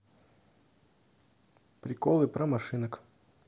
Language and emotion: Russian, neutral